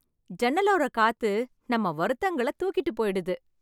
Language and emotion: Tamil, happy